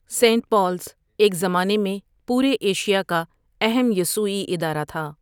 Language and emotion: Urdu, neutral